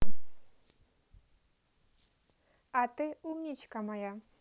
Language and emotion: Russian, positive